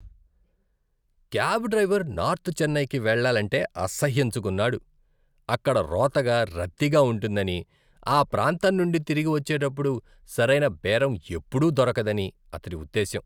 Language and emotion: Telugu, disgusted